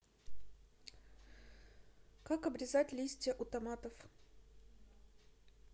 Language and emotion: Russian, neutral